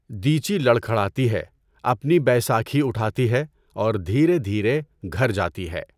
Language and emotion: Urdu, neutral